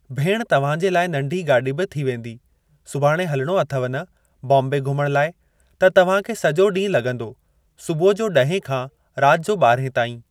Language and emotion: Sindhi, neutral